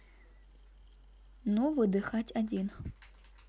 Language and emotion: Russian, neutral